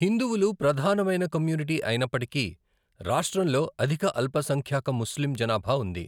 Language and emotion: Telugu, neutral